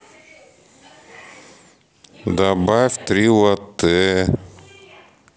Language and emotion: Russian, neutral